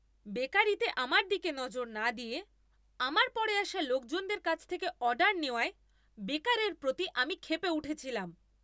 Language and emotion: Bengali, angry